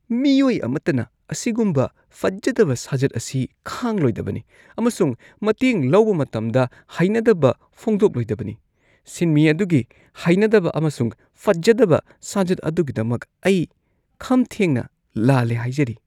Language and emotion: Manipuri, disgusted